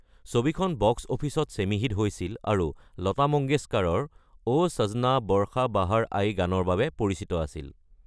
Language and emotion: Assamese, neutral